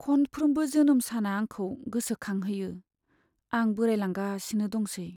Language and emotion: Bodo, sad